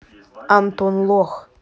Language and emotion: Russian, neutral